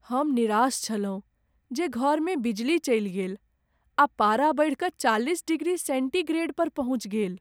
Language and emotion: Maithili, sad